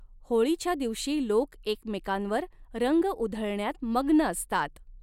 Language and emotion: Marathi, neutral